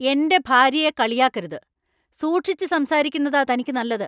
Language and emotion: Malayalam, angry